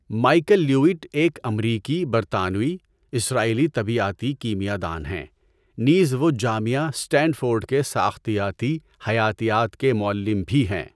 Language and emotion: Urdu, neutral